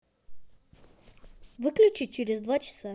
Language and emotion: Russian, positive